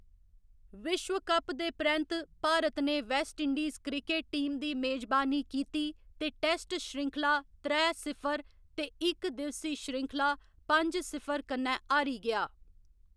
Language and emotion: Dogri, neutral